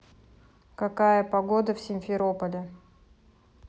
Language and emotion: Russian, neutral